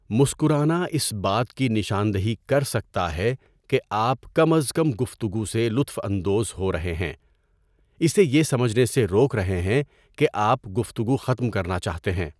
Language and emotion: Urdu, neutral